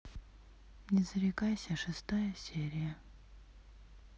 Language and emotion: Russian, sad